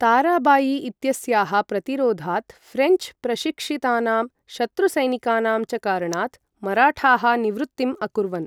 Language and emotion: Sanskrit, neutral